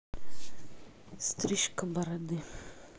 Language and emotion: Russian, neutral